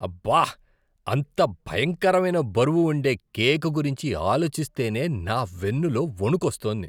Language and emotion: Telugu, disgusted